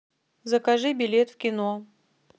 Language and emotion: Russian, neutral